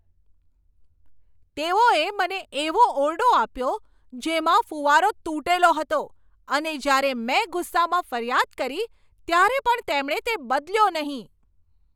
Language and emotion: Gujarati, angry